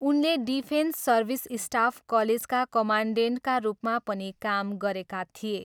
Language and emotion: Nepali, neutral